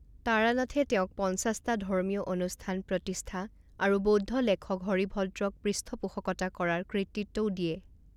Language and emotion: Assamese, neutral